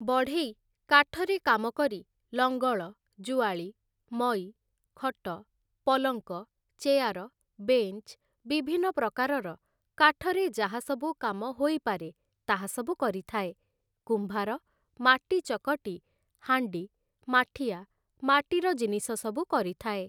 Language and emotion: Odia, neutral